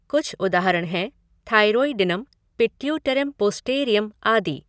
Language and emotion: Hindi, neutral